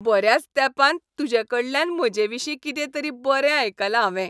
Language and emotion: Goan Konkani, happy